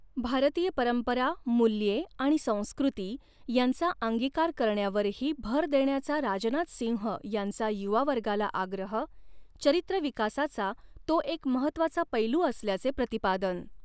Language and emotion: Marathi, neutral